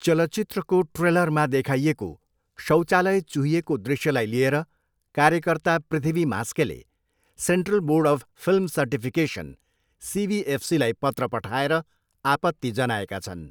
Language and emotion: Nepali, neutral